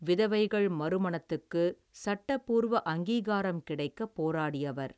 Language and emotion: Tamil, neutral